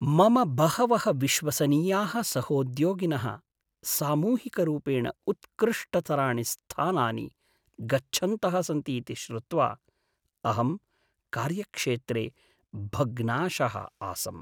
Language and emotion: Sanskrit, sad